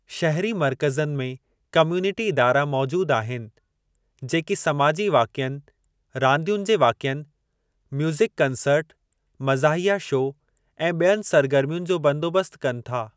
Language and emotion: Sindhi, neutral